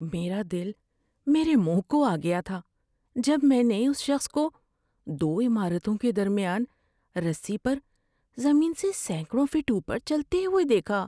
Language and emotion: Urdu, fearful